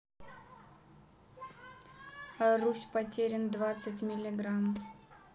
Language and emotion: Russian, neutral